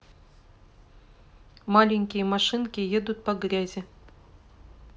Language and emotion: Russian, neutral